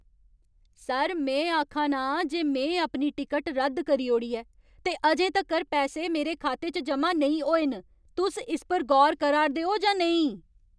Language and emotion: Dogri, angry